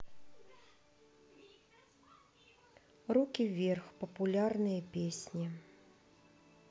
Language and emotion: Russian, neutral